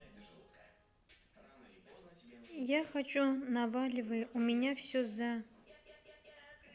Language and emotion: Russian, neutral